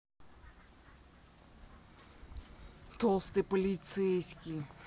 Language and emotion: Russian, angry